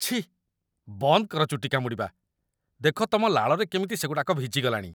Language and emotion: Odia, disgusted